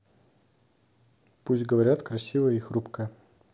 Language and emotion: Russian, neutral